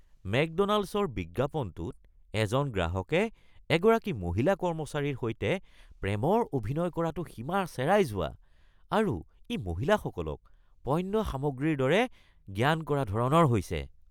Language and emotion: Assamese, disgusted